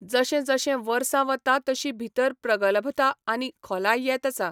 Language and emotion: Goan Konkani, neutral